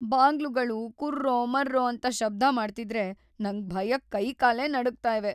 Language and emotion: Kannada, fearful